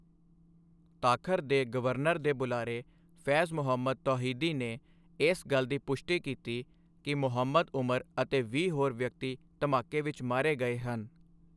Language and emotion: Punjabi, neutral